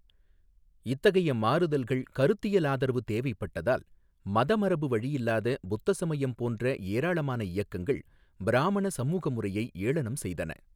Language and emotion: Tamil, neutral